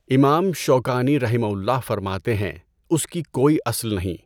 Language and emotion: Urdu, neutral